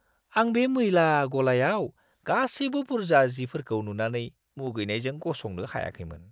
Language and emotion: Bodo, disgusted